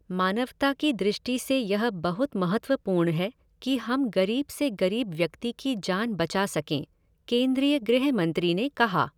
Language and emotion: Hindi, neutral